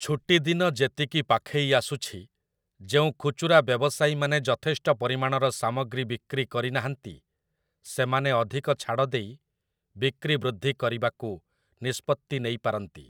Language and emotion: Odia, neutral